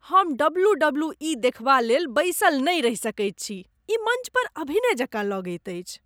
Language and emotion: Maithili, disgusted